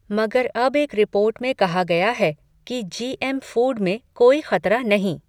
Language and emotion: Hindi, neutral